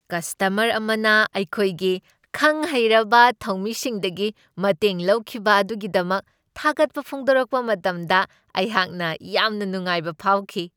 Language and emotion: Manipuri, happy